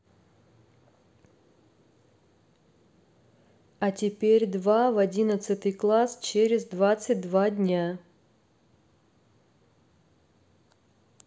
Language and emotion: Russian, neutral